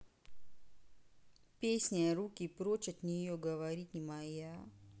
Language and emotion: Russian, neutral